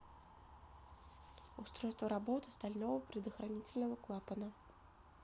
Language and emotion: Russian, neutral